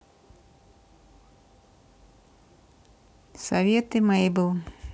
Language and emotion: Russian, neutral